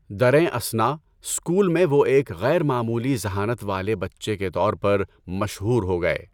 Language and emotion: Urdu, neutral